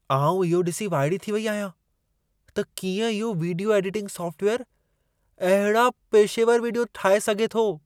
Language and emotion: Sindhi, surprised